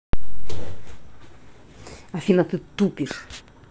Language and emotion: Russian, angry